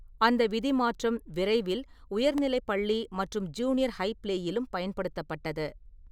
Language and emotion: Tamil, neutral